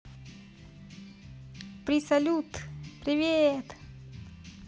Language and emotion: Russian, positive